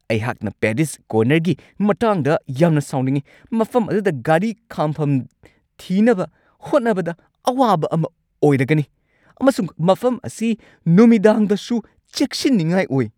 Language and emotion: Manipuri, angry